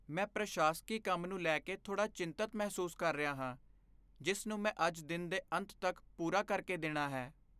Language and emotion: Punjabi, fearful